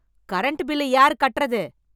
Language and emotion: Tamil, angry